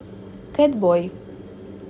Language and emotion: Russian, neutral